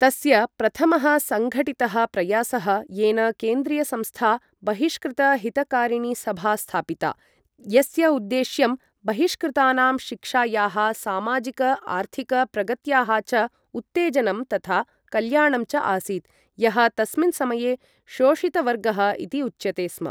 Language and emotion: Sanskrit, neutral